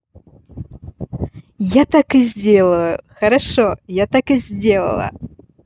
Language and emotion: Russian, positive